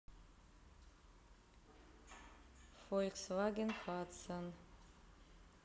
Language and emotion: Russian, neutral